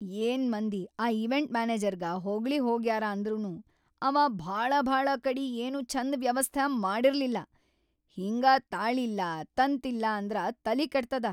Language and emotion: Kannada, angry